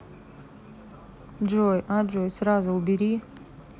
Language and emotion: Russian, neutral